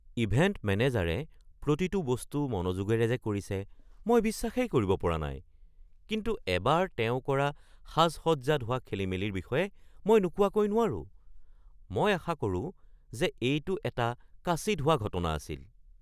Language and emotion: Assamese, surprised